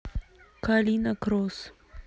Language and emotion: Russian, neutral